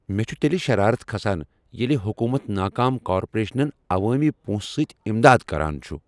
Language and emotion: Kashmiri, angry